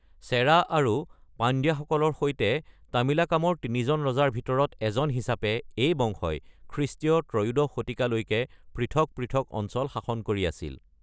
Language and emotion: Assamese, neutral